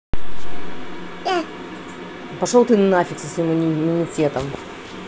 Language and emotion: Russian, angry